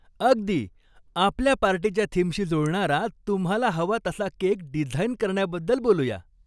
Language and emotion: Marathi, happy